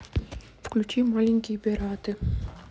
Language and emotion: Russian, neutral